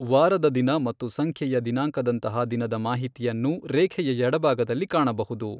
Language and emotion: Kannada, neutral